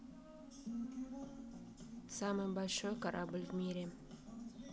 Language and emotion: Russian, neutral